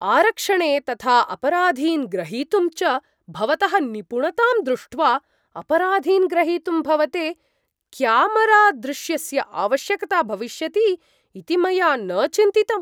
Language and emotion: Sanskrit, surprised